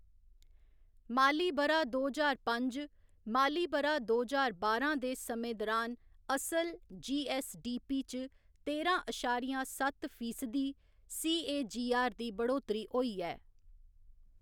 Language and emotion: Dogri, neutral